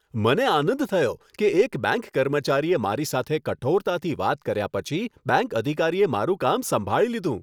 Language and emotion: Gujarati, happy